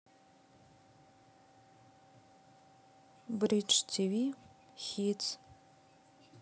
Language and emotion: Russian, sad